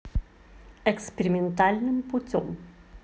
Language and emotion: Russian, positive